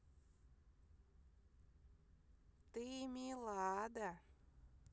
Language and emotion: Russian, neutral